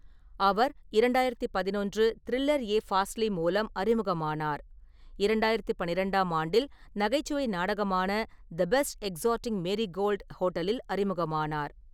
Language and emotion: Tamil, neutral